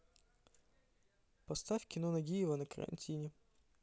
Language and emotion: Russian, neutral